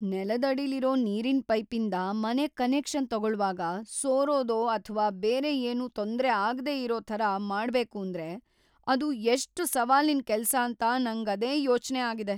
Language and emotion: Kannada, fearful